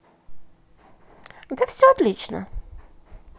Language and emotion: Russian, positive